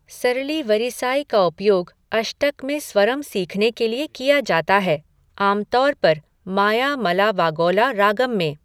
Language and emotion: Hindi, neutral